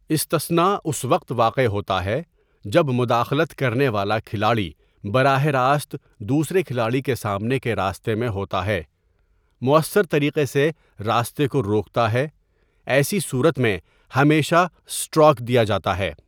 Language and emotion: Urdu, neutral